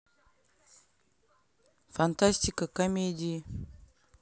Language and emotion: Russian, neutral